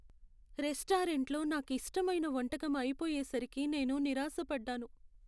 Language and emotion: Telugu, sad